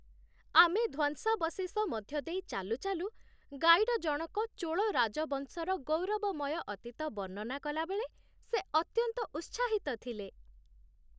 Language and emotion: Odia, happy